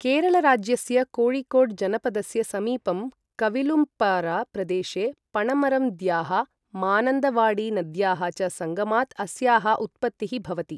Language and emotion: Sanskrit, neutral